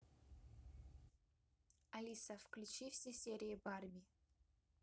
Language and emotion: Russian, neutral